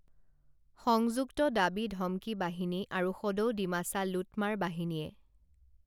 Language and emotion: Assamese, neutral